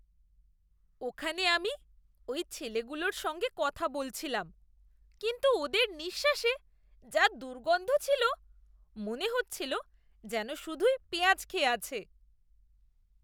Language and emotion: Bengali, disgusted